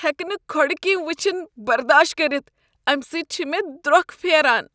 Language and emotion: Kashmiri, disgusted